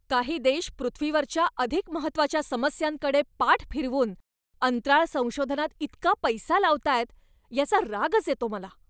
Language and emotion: Marathi, angry